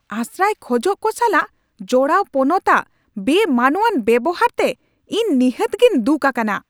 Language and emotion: Santali, angry